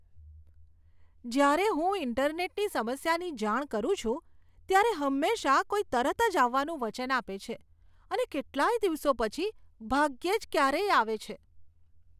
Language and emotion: Gujarati, disgusted